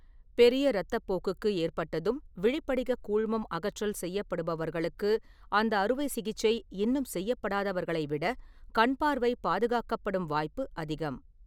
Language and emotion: Tamil, neutral